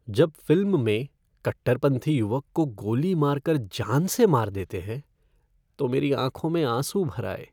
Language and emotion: Hindi, sad